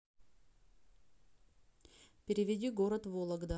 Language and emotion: Russian, neutral